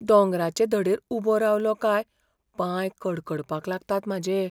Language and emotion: Goan Konkani, fearful